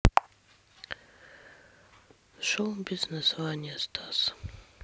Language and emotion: Russian, sad